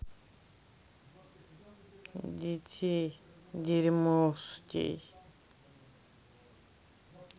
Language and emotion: Russian, sad